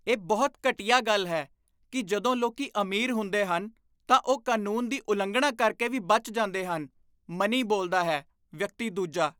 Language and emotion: Punjabi, disgusted